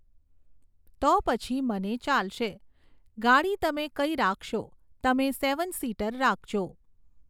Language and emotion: Gujarati, neutral